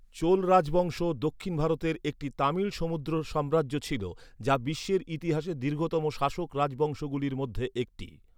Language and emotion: Bengali, neutral